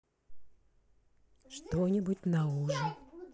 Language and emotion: Russian, neutral